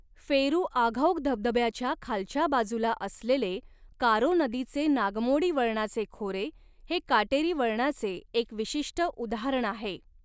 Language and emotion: Marathi, neutral